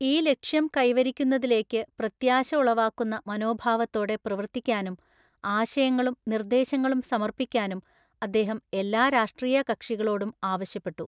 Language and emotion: Malayalam, neutral